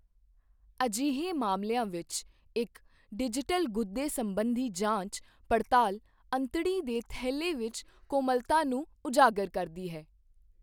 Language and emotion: Punjabi, neutral